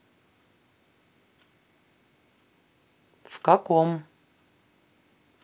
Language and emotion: Russian, neutral